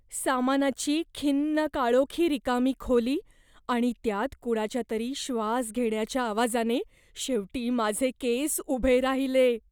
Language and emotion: Marathi, fearful